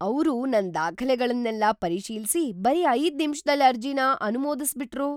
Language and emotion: Kannada, surprised